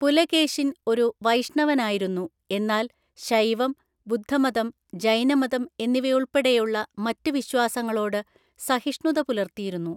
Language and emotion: Malayalam, neutral